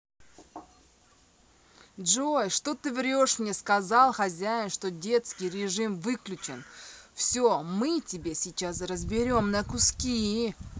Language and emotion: Russian, neutral